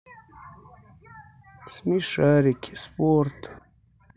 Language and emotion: Russian, sad